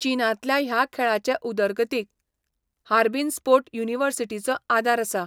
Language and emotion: Goan Konkani, neutral